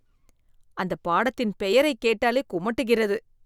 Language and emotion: Tamil, disgusted